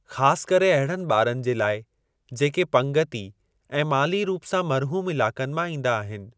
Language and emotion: Sindhi, neutral